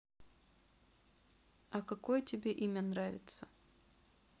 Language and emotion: Russian, neutral